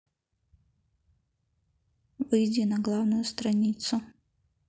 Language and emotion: Russian, neutral